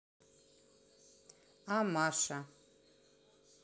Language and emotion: Russian, neutral